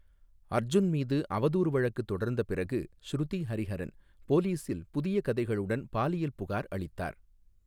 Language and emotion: Tamil, neutral